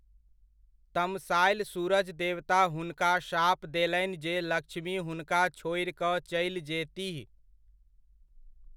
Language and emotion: Maithili, neutral